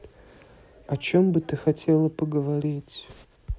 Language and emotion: Russian, sad